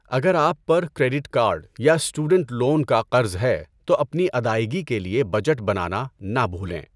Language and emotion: Urdu, neutral